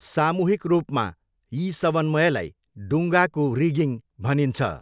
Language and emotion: Nepali, neutral